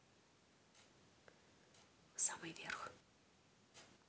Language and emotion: Russian, neutral